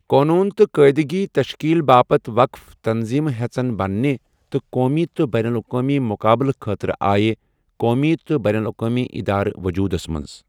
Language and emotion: Kashmiri, neutral